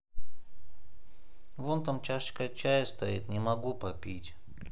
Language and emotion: Russian, sad